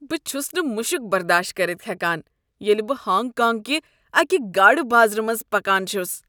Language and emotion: Kashmiri, disgusted